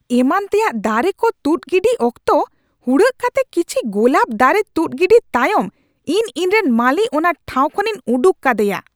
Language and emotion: Santali, angry